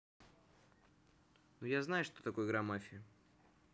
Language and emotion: Russian, neutral